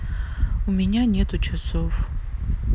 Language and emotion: Russian, sad